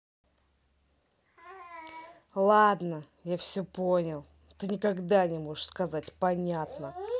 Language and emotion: Russian, angry